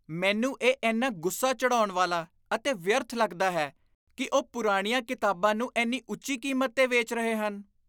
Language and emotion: Punjabi, disgusted